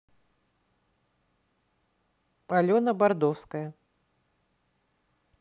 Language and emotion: Russian, neutral